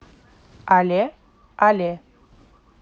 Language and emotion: Russian, neutral